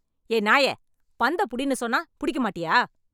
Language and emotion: Tamil, angry